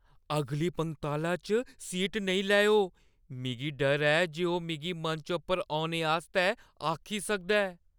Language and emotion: Dogri, fearful